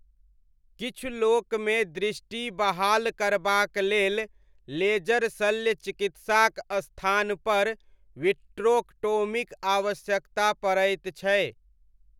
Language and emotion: Maithili, neutral